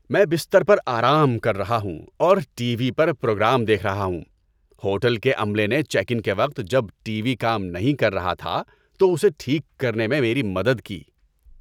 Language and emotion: Urdu, happy